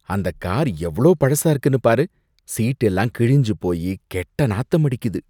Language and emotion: Tamil, disgusted